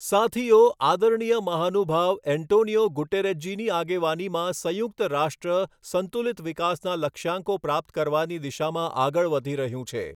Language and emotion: Gujarati, neutral